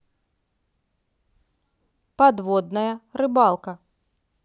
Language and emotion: Russian, neutral